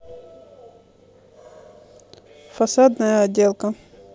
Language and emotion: Russian, neutral